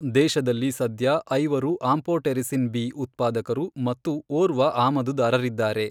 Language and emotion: Kannada, neutral